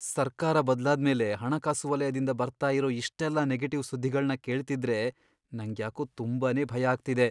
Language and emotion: Kannada, fearful